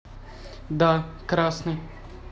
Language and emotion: Russian, neutral